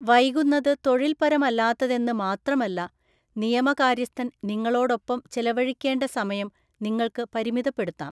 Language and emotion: Malayalam, neutral